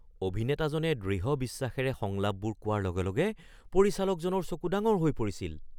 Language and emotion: Assamese, surprised